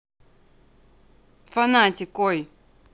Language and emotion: Russian, neutral